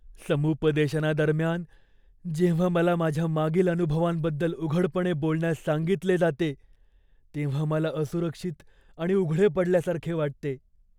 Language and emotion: Marathi, fearful